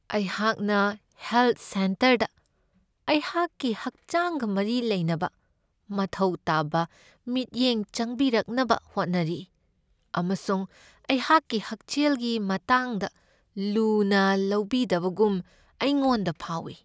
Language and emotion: Manipuri, sad